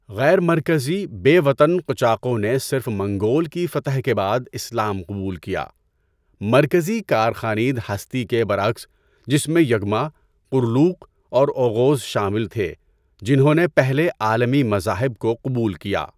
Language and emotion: Urdu, neutral